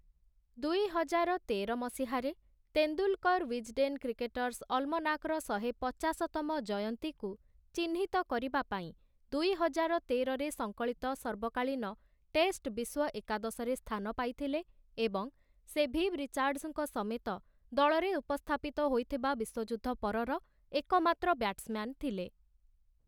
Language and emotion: Odia, neutral